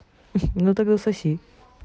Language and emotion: Russian, positive